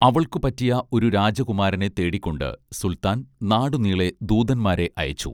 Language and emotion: Malayalam, neutral